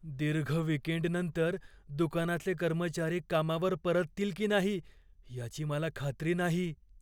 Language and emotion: Marathi, fearful